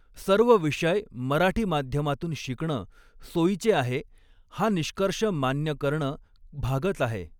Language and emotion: Marathi, neutral